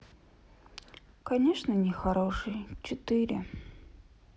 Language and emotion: Russian, sad